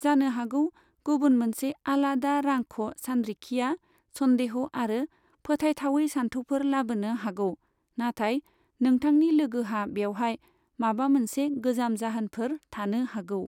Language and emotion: Bodo, neutral